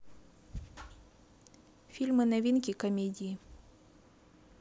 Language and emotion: Russian, neutral